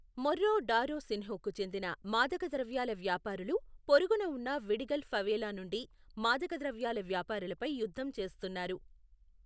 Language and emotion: Telugu, neutral